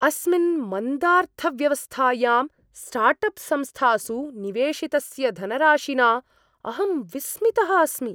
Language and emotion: Sanskrit, surprised